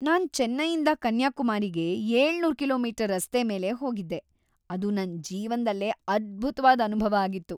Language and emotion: Kannada, happy